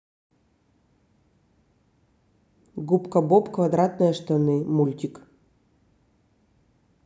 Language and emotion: Russian, neutral